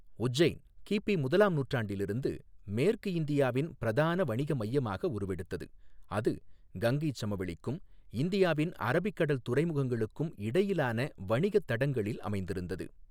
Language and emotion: Tamil, neutral